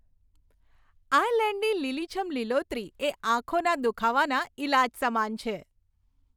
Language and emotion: Gujarati, happy